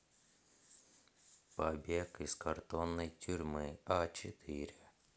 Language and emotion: Russian, neutral